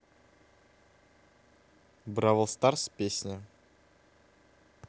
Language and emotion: Russian, neutral